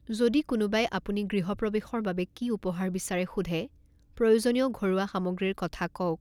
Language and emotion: Assamese, neutral